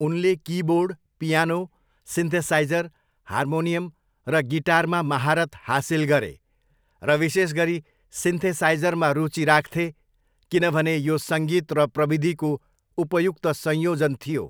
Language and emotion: Nepali, neutral